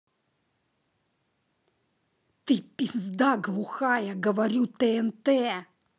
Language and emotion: Russian, angry